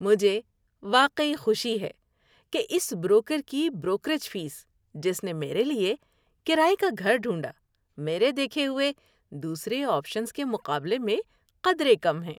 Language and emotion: Urdu, happy